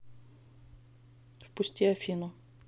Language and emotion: Russian, neutral